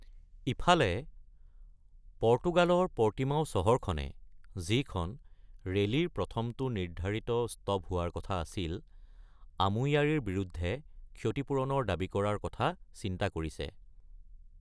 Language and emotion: Assamese, neutral